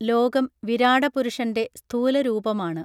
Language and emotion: Malayalam, neutral